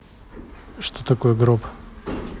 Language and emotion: Russian, neutral